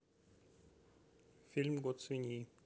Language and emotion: Russian, neutral